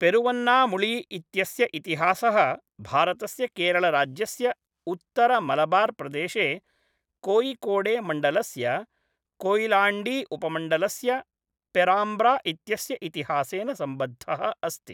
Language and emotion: Sanskrit, neutral